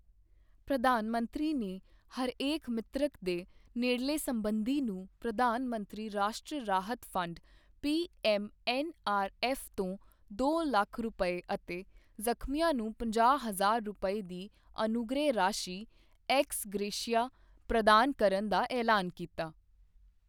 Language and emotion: Punjabi, neutral